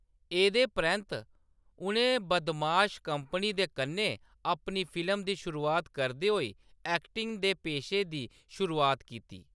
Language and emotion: Dogri, neutral